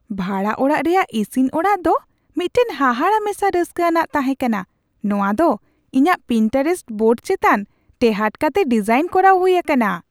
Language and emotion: Santali, surprised